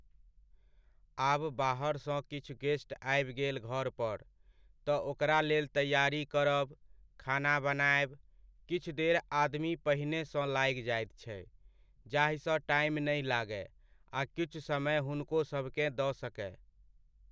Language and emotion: Maithili, neutral